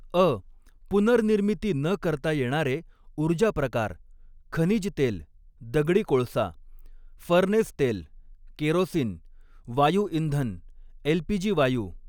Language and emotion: Marathi, neutral